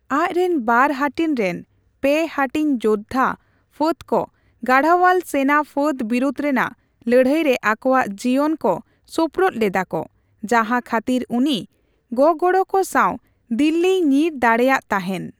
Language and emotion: Santali, neutral